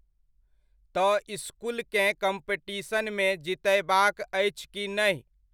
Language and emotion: Maithili, neutral